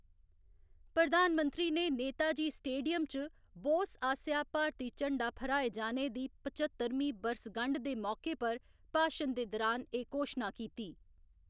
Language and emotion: Dogri, neutral